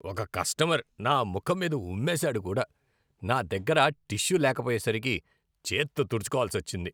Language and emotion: Telugu, disgusted